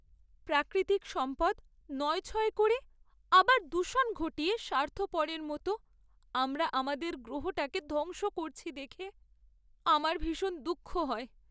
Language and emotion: Bengali, sad